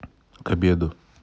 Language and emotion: Russian, neutral